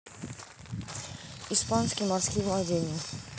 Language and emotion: Russian, neutral